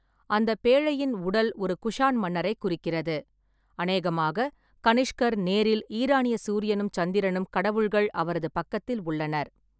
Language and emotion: Tamil, neutral